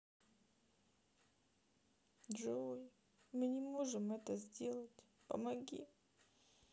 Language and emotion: Russian, sad